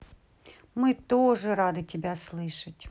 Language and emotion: Russian, positive